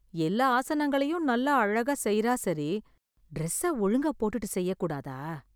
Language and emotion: Tamil, disgusted